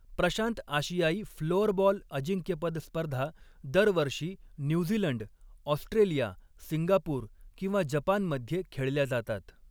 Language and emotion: Marathi, neutral